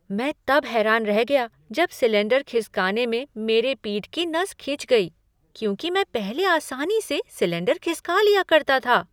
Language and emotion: Hindi, surprised